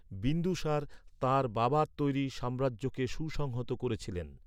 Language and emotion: Bengali, neutral